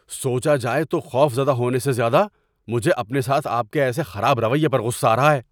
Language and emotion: Urdu, angry